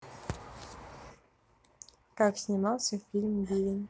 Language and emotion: Russian, neutral